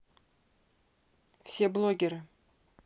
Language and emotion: Russian, neutral